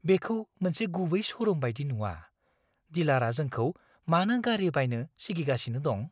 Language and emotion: Bodo, fearful